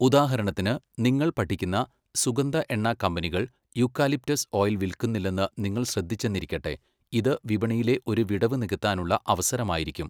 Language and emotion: Malayalam, neutral